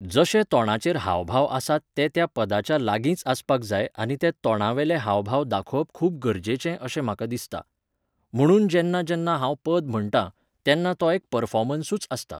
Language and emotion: Goan Konkani, neutral